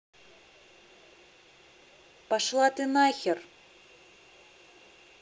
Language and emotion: Russian, angry